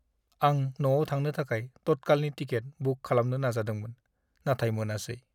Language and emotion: Bodo, sad